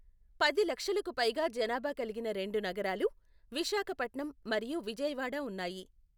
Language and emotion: Telugu, neutral